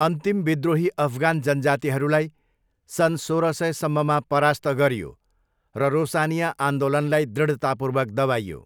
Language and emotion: Nepali, neutral